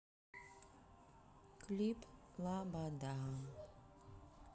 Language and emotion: Russian, sad